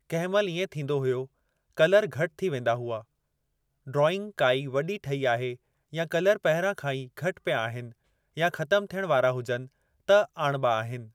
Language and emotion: Sindhi, neutral